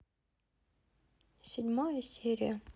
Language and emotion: Russian, sad